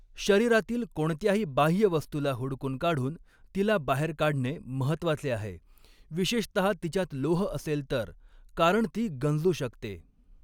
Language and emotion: Marathi, neutral